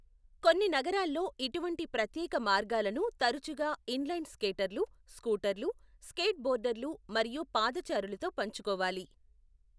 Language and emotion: Telugu, neutral